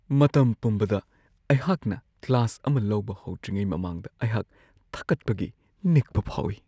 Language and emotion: Manipuri, fearful